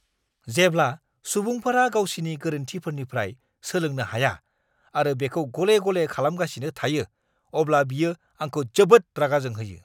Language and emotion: Bodo, angry